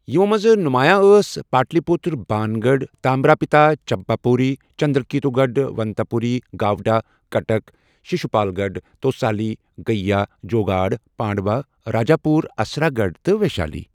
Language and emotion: Kashmiri, neutral